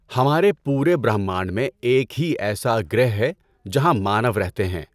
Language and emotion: Urdu, neutral